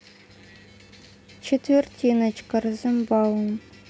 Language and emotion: Russian, neutral